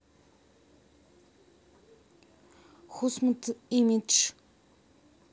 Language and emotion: Russian, neutral